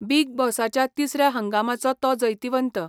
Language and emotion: Goan Konkani, neutral